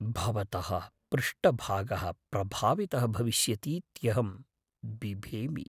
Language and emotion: Sanskrit, fearful